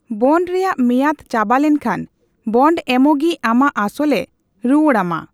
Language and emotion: Santali, neutral